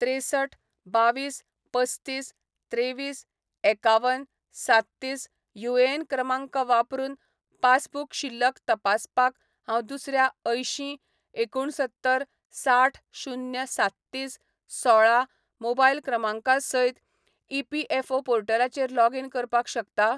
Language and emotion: Goan Konkani, neutral